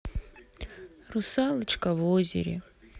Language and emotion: Russian, sad